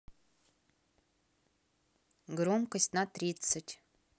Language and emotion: Russian, neutral